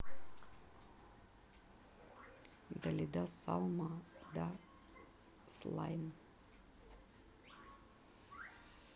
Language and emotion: Russian, neutral